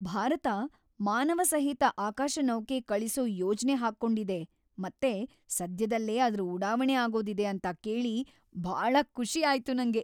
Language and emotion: Kannada, happy